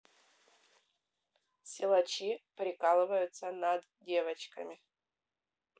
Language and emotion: Russian, neutral